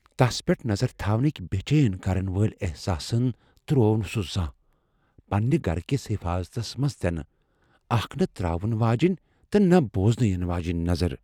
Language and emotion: Kashmiri, fearful